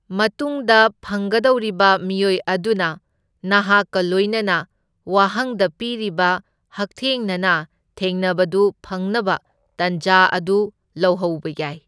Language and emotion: Manipuri, neutral